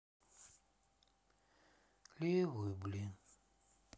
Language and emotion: Russian, sad